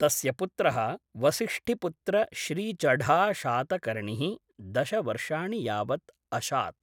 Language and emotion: Sanskrit, neutral